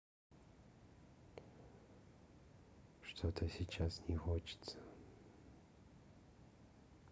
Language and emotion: Russian, sad